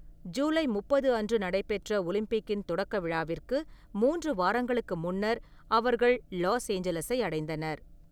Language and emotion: Tamil, neutral